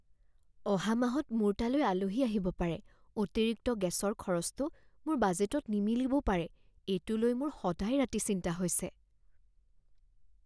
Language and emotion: Assamese, fearful